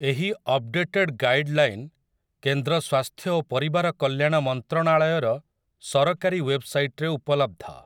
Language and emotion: Odia, neutral